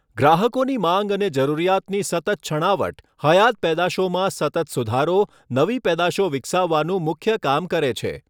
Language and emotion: Gujarati, neutral